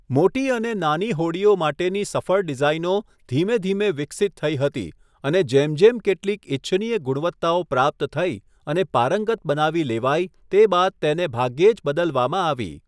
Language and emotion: Gujarati, neutral